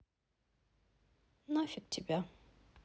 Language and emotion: Russian, sad